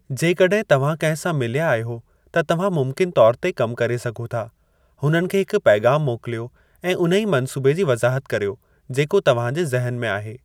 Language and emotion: Sindhi, neutral